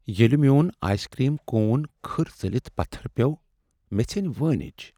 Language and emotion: Kashmiri, sad